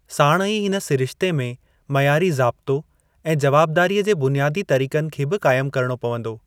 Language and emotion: Sindhi, neutral